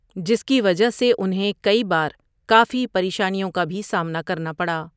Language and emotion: Urdu, neutral